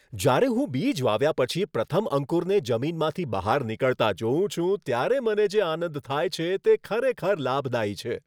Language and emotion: Gujarati, happy